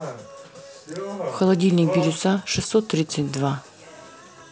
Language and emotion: Russian, neutral